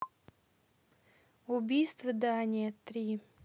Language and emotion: Russian, neutral